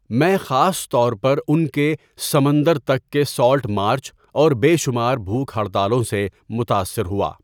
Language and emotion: Urdu, neutral